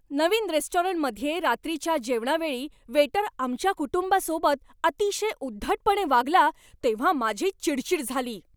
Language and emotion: Marathi, angry